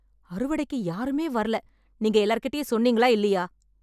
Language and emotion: Tamil, angry